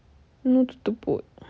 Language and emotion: Russian, sad